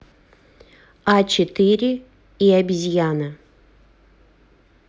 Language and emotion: Russian, neutral